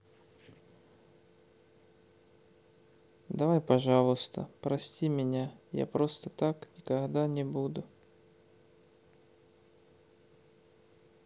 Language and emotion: Russian, sad